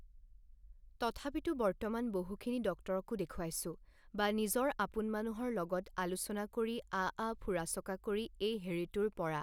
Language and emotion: Assamese, neutral